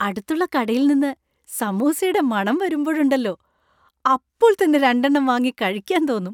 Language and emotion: Malayalam, happy